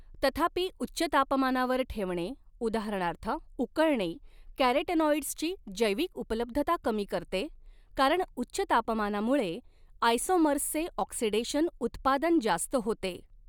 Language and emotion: Marathi, neutral